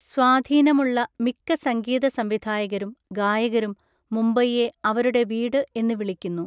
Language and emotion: Malayalam, neutral